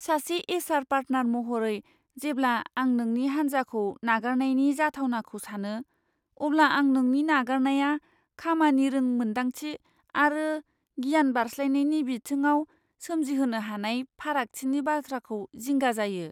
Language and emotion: Bodo, fearful